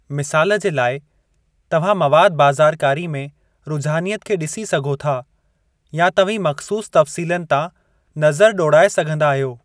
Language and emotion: Sindhi, neutral